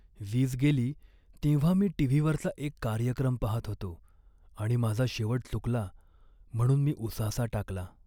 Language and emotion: Marathi, sad